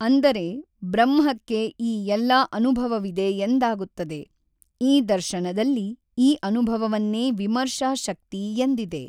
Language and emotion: Kannada, neutral